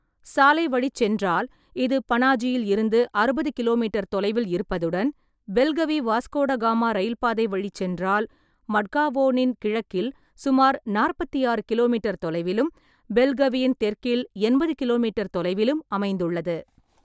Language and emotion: Tamil, neutral